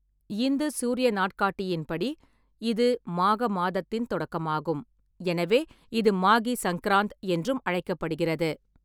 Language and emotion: Tamil, neutral